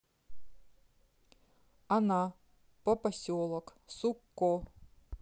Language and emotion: Russian, neutral